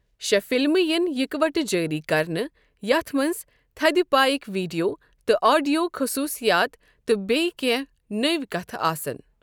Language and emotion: Kashmiri, neutral